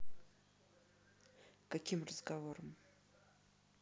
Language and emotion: Russian, neutral